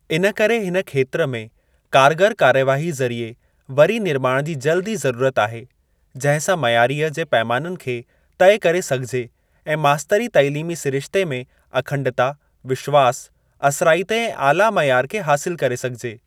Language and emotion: Sindhi, neutral